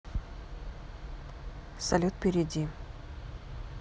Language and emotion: Russian, neutral